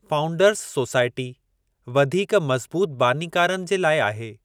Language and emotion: Sindhi, neutral